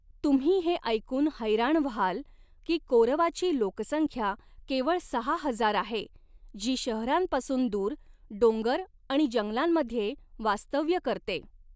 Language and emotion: Marathi, neutral